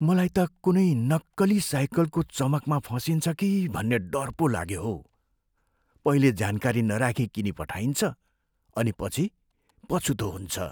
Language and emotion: Nepali, fearful